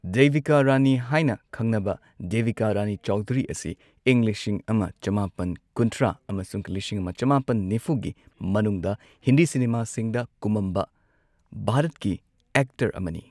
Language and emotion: Manipuri, neutral